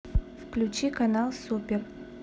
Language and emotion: Russian, neutral